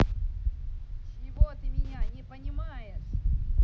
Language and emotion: Russian, angry